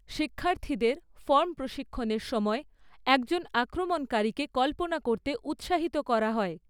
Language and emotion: Bengali, neutral